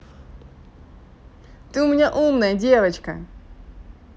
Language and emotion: Russian, positive